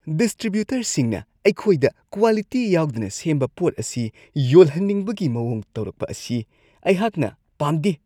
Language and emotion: Manipuri, disgusted